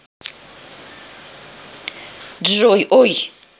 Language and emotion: Russian, neutral